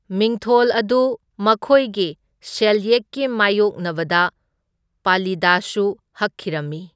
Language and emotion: Manipuri, neutral